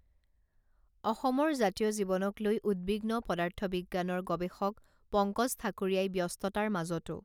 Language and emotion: Assamese, neutral